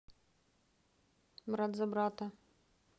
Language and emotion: Russian, neutral